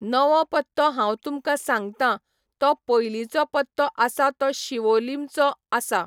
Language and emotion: Goan Konkani, neutral